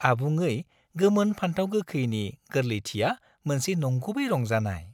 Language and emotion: Bodo, happy